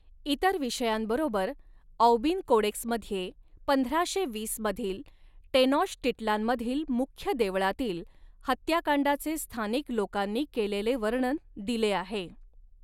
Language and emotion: Marathi, neutral